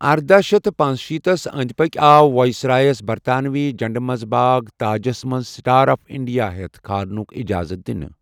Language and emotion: Kashmiri, neutral